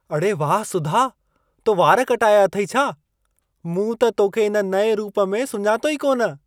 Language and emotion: Sindhi, surprised